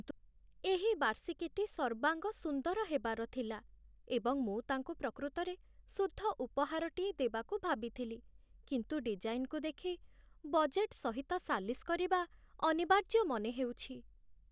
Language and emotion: Odia, sad